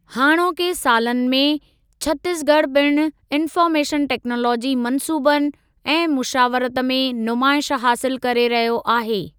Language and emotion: Sindhi, neutral